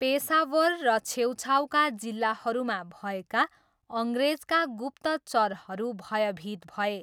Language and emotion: Nepali, neutral